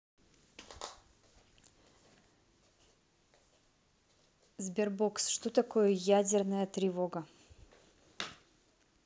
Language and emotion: Russian, neutral